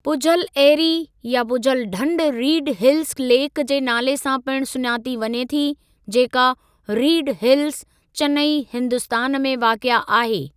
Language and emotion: Sindhi, neutral